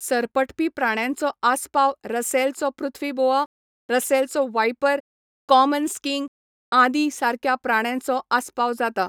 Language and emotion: Goan Konkani, neutral